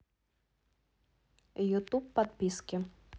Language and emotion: Russian, neutral